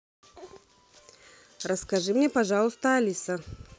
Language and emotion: Russian, neutral